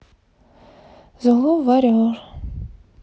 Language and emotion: Russian, sad